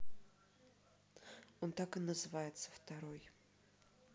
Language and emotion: Russian, neutral